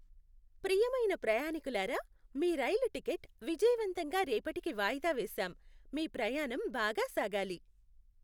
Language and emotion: Telugu, happy